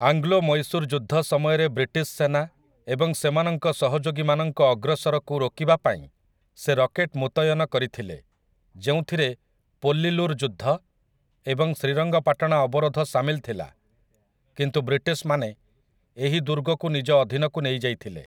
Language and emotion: Odia, neutral